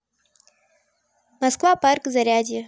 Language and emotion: Russian, neutral